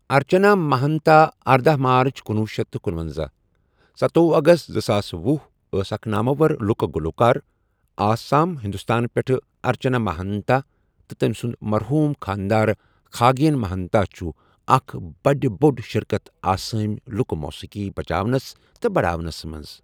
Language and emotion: Kashmiri, neutral